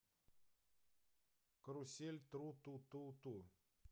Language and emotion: Russian, neutral